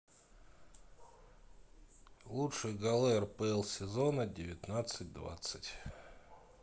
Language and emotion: Russian, neutral